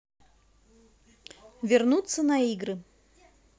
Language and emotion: Russian, positive